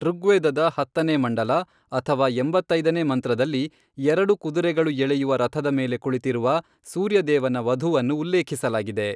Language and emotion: Kannada, neutral